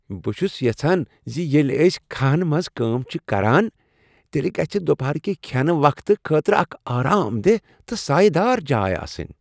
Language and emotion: Kashmiri, happy